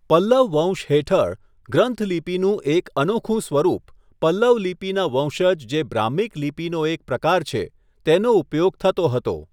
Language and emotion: Gujarati, neutral